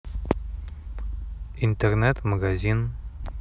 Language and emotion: Russian, neutral